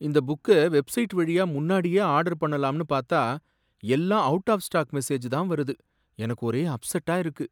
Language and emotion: Tamil, sad